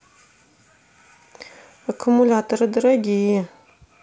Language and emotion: Russian, neutral